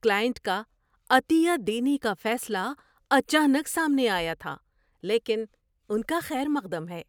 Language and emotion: Urdu, surprised